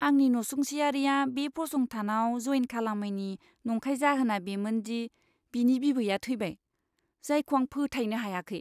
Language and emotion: Bodo, disgusted